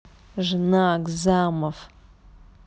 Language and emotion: Russian, angry